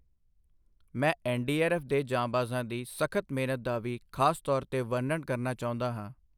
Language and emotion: Punjabi, neutral